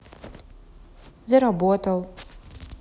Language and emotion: Russian, neutral